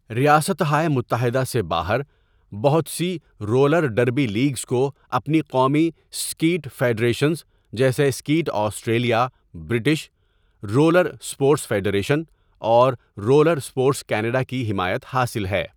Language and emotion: Urdu, neutral